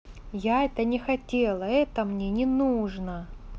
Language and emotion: Russian, angry